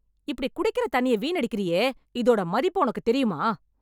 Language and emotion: Tamil, angry